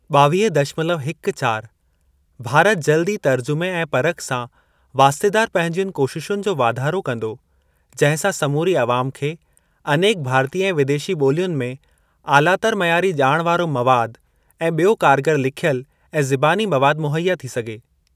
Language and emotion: Sindhi, neutral